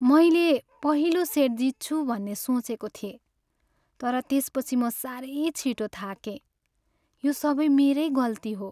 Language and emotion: Nepali, sad